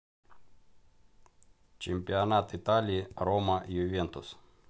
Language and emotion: Russian, neutral